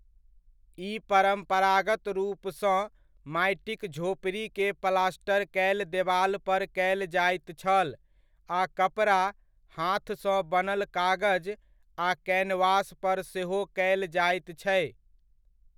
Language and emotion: Maithili, neutral